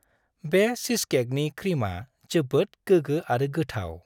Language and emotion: Bodo, happy